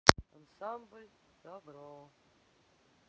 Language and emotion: Russian, sad